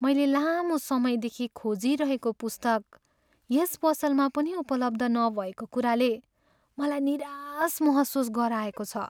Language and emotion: Nepali, sad